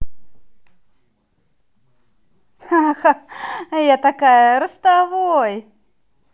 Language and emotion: Russian, positive